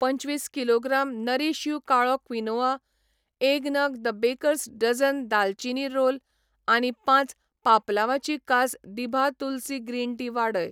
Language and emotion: Goan Konkani, neutral